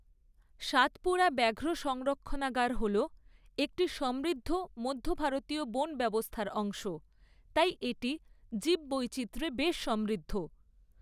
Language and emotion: Bengali, neutral